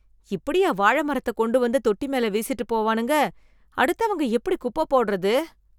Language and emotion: Tamil, disgusted